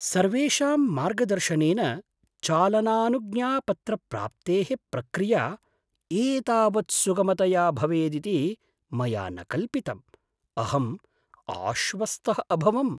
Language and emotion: Sanskrit, surprised